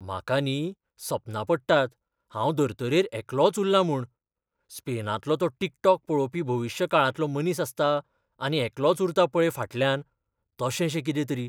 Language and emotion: Goan Konkani, fearful